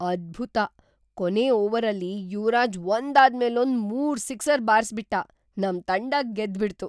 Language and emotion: Kannada, surprised